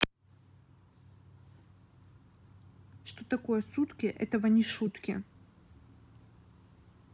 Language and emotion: Russian, neutral